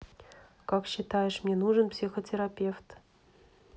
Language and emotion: Russian, neutral